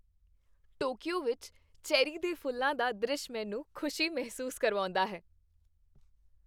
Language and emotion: Punjabi, happy